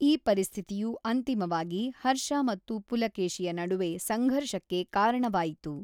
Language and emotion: Kannada, neutral